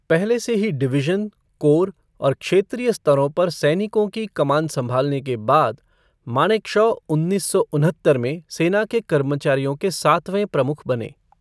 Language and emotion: Hindi, neutral